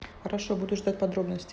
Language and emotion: Russian, neutral